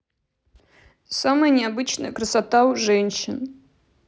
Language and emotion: Russian, sad